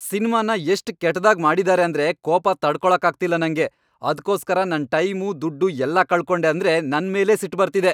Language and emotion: Kannada, angry